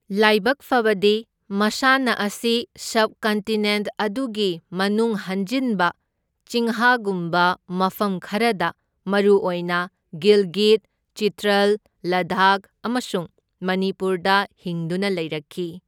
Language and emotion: Manipuri, neutral